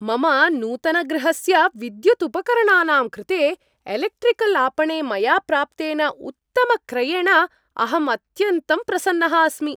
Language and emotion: Sanskrit, happy